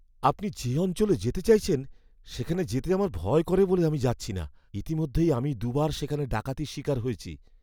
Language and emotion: Bengali, fearful